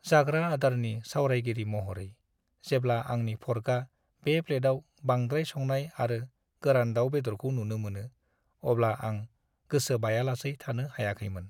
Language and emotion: Bodo, sad